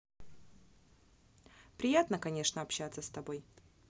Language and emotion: Russian, neutral